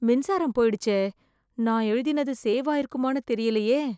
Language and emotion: Tamil, fearful